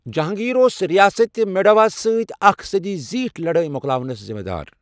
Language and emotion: Kashmiri, neutral